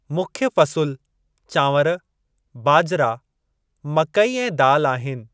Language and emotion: Sindhi, neutral